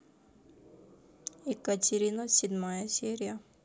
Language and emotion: Russian, neutral